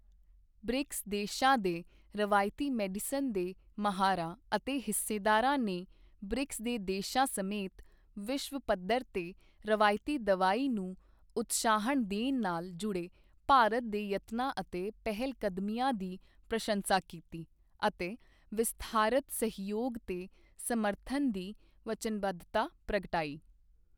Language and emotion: Punjabi, neutral